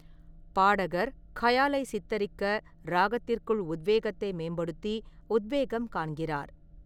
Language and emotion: Tamil, neutral